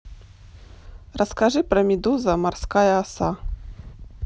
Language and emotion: Russian, neutral